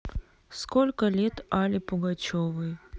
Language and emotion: Russian, sad